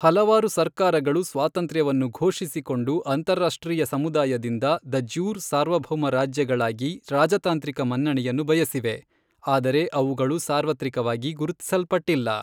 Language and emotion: Kannada, neutral